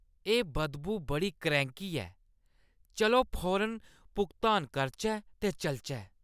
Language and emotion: Dogri, disgusted